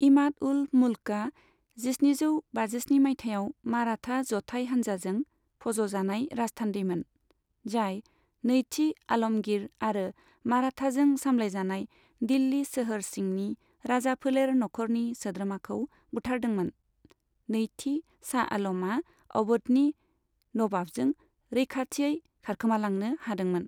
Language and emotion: Bodo, neutral